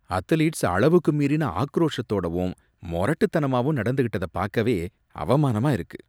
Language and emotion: Tamil, disgusted